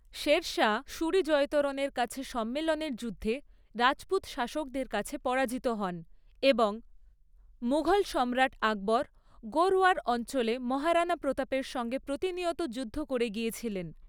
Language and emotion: Bengali, neutral